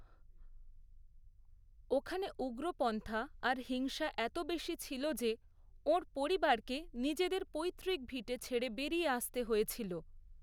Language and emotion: Bengali, neutral